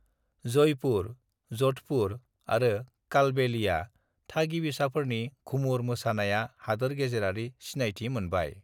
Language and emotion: Bodo, neutral